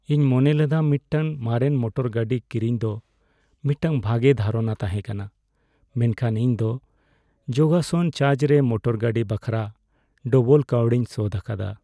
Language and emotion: Santali, sad